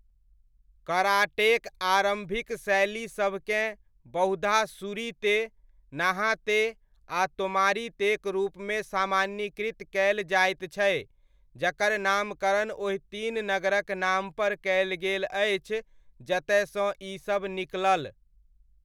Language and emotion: Maithili, neutral